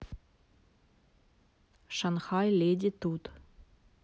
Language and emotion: Russian, neutral